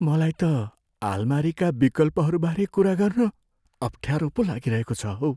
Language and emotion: Nepali, fearful